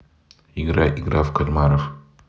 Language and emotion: Russian, neutral